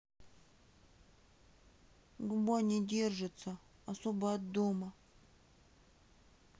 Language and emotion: Russian, sad